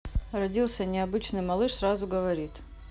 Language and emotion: Russian, neutral